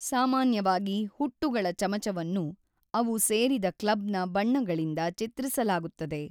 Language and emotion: Kannada, neutral